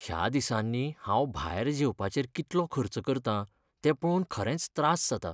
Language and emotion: Goan Konkani, sad